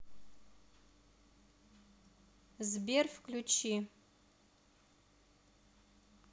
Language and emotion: Russian, neutral